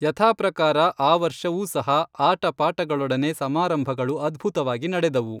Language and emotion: Kannada, neutral